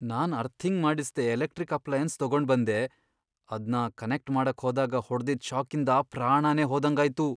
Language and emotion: Kannada, fearful